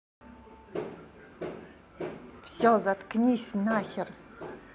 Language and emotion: Russian, angry